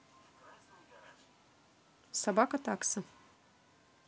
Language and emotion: Russian, neutral